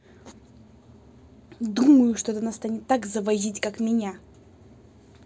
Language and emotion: Russian, angry